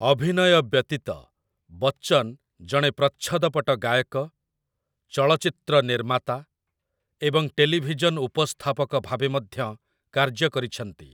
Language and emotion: Odia, neutral